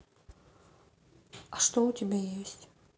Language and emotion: Russian, neutral